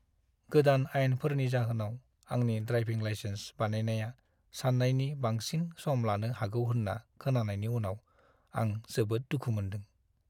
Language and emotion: Bodo, sad